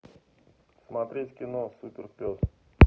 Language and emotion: Russian, neutral